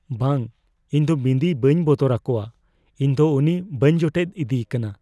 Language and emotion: Santali, fearful